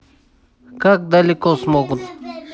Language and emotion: Russian, neutral